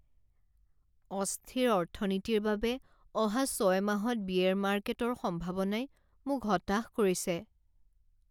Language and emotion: Assamese, sad